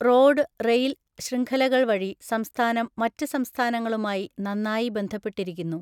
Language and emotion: Malayalam, neutral